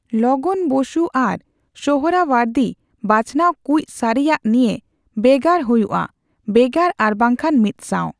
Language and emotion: Santali, neutral